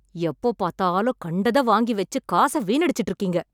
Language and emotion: Tamil, angry